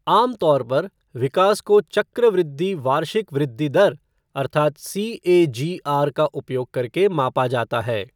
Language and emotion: Hindi, neutral